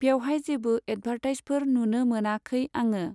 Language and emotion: Bodo, neutral